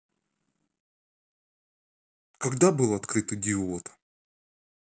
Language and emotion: Russian, neutral